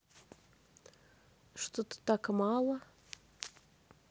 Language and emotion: Russian, neutral